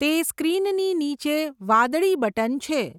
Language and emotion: Gujarati, neutral